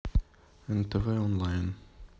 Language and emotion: Russian, neutral